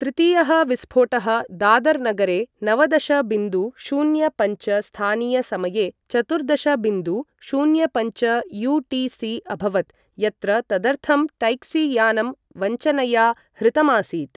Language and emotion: Sanskrit, neutral